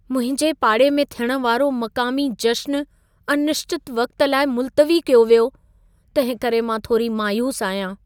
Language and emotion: Sindhi, sad